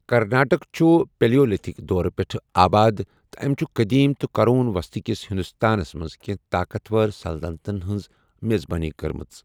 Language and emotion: Kashmiri, neutral